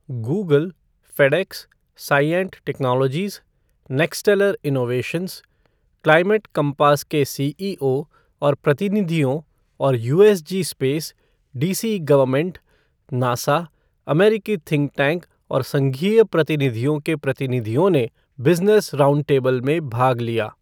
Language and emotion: Hindi, neutral